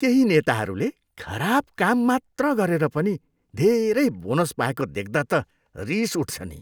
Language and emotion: Nepali, disgusted